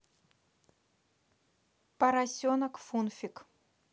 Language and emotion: Russian, neutral